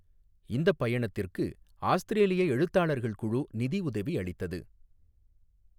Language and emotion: Tamil, neutral